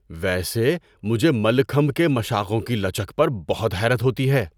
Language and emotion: Urdu, surprised